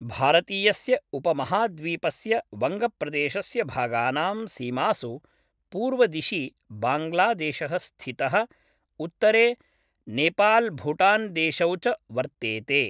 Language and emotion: Sanskrit, neutral